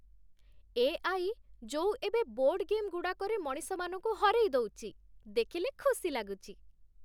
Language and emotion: Odia, happy